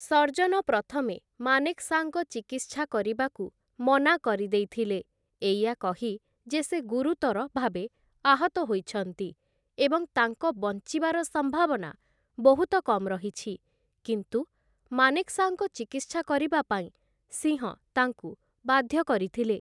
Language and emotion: Odia, neutral